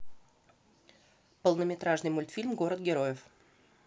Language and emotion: Russian, neutral